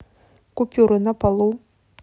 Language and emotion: Russian, neutral